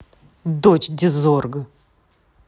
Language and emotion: Russian, angry